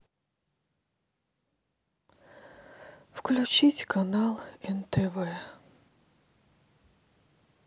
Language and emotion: Russian, sad